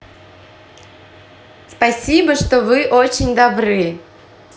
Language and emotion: Russian, positive